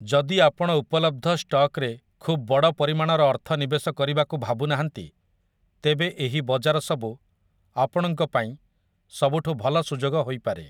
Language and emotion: Odia, neutral